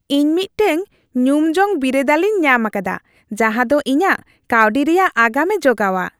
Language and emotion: Santali, happy